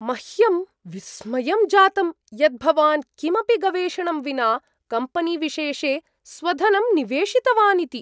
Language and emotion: Sanskrit, surprised